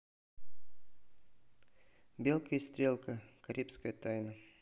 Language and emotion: Russian, neutral